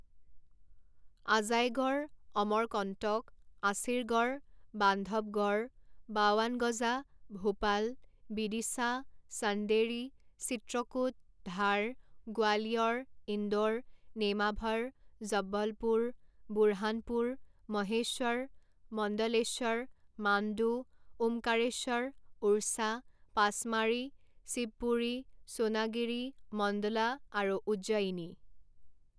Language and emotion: Assamese, neutral